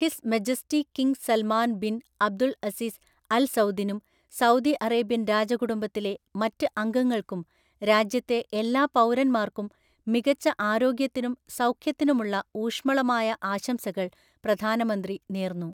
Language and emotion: Malayalam, neutral